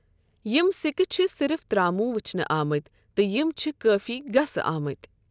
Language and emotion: Kashmiri, neutral